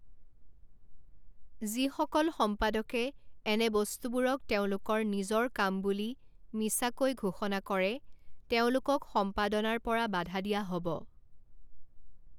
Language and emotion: Assamese, neutral